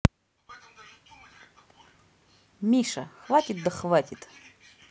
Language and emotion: Russian, neutral